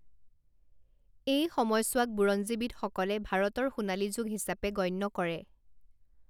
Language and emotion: Assamese, neutral